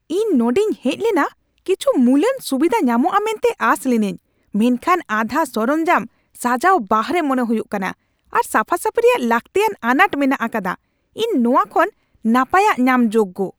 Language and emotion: Santali, angry